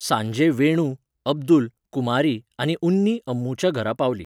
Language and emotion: Goan Konkani, neutral